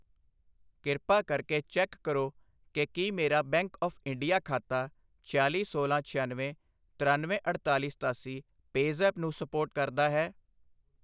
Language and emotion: Punjabi, neutral